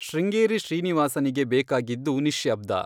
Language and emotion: Kannada, neutral